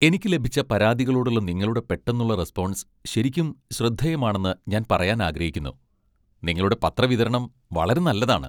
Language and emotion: Malayalam, happy